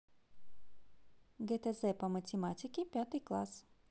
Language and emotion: Russian, positive